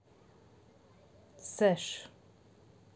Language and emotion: Russian, neutral